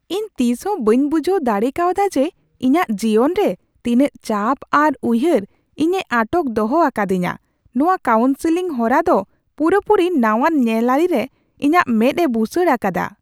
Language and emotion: Santali, surprised